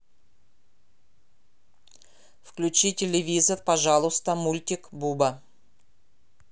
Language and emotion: Russian, neutral